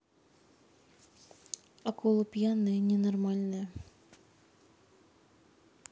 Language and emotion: Russian, sad